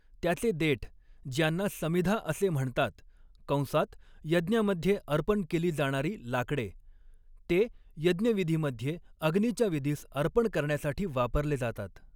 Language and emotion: Marathi, neutral